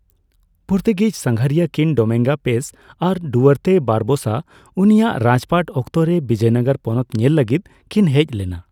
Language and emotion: Santali, neutral